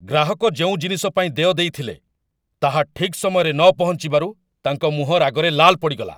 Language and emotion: Odia, angry